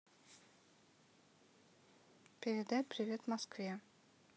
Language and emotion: Russian, neutral